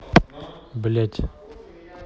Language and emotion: Russian, angry